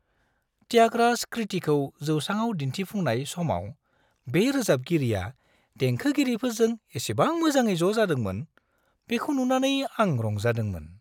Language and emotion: Bodo, happy